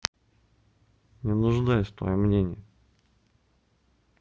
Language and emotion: Russian, neutral